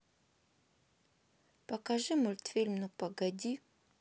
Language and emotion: Russian, neutral